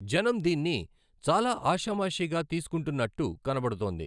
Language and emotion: Telugu, neutral